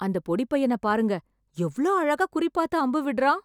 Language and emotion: Tamil, surprised